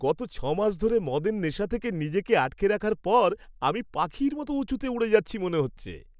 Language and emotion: Bengali, happy